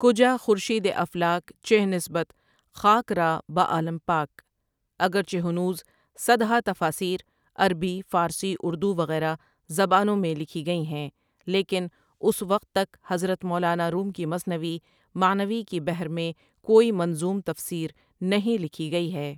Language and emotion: Urdu, neutral